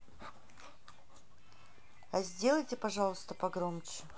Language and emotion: Russian, neutral